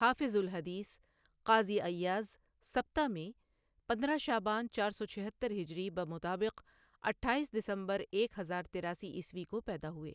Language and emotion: Urdu, neutral